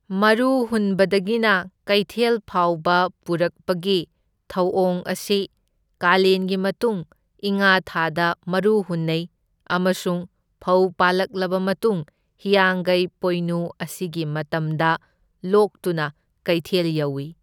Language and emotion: Manipuri, neutral